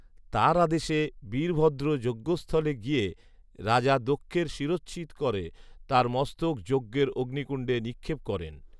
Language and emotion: Bengali, neutral